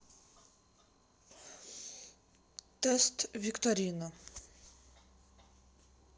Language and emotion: Russian, neutral